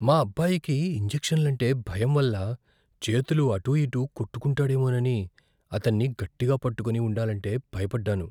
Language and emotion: Telugu, fearful